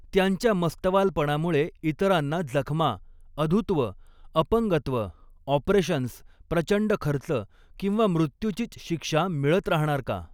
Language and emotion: Marathi, neutral